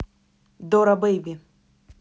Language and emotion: Russian, neutral